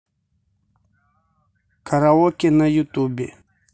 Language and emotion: Russian, neutral